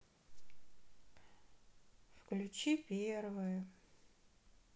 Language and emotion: Russian, sad